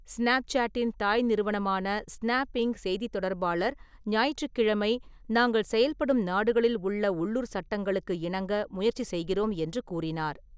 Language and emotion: Tamil, neutral